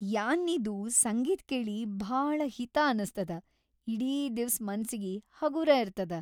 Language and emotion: Kannada, happy